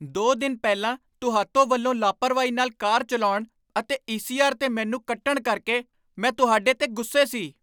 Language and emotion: Punjabi, angry